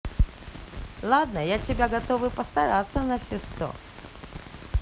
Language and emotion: Russian, positive